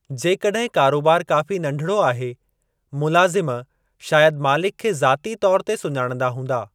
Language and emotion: Sindhi, neutral